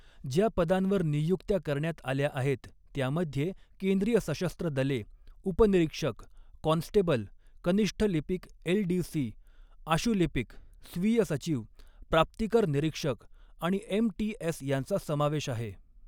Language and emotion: Marathi, neutral